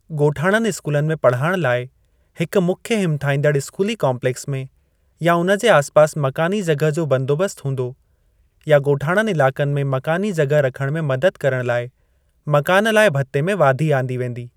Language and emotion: Sindhi, neutral